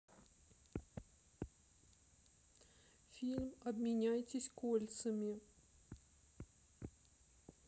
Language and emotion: Russian, sad